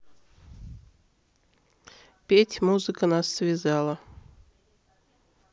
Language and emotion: Russian, neutral